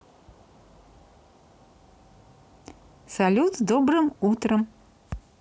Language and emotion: Russian, positive